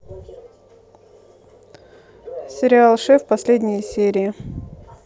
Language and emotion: Russian, neutral